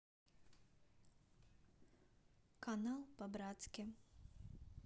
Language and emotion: Russian, neutral